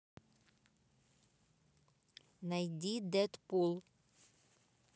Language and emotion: Russian, neutral